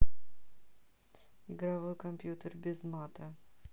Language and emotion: Russian, neutral